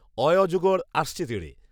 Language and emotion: Bengali, neutral